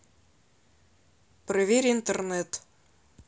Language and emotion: Russian, neutral